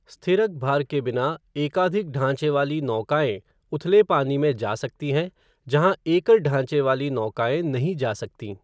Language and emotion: Hindi, neutral